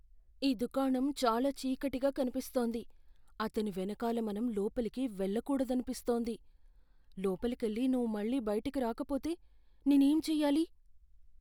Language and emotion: Telugu, fearful